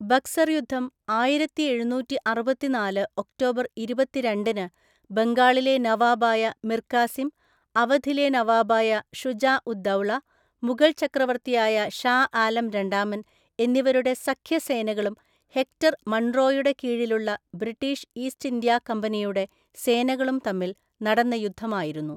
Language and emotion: Malayalam, neutral